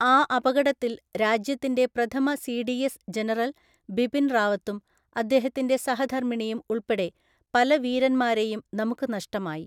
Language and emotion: Malayalam, neutral